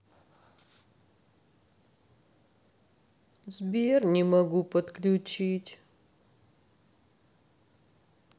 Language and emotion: Russian, sad